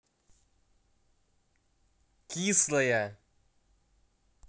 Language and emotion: Russian, neutral